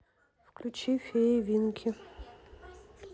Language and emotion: Russian, neutral